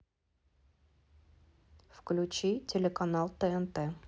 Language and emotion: Russian, neutral